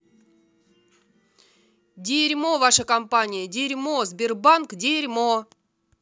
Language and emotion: Russian, angry